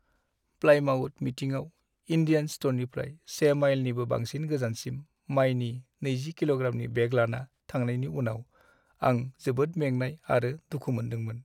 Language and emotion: Bodo, sad